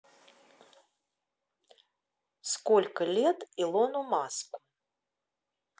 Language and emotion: Russian, neutral